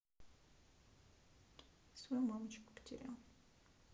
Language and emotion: Russian, sad